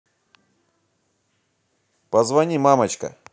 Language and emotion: Russian, positive